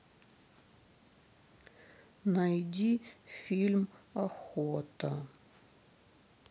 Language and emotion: Russian, sad